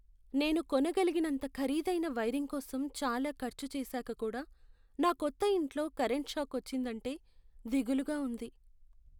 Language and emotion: Telugu, sad